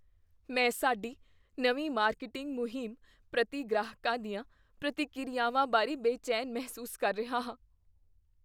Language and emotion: Punjabi, fearful